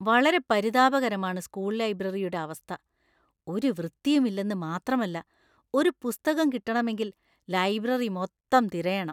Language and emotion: Malayalam, disgusted